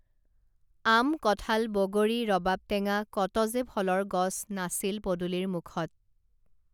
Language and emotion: Assamese, neutral